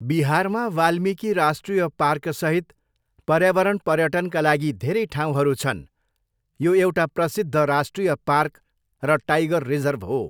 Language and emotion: Nepali, neutral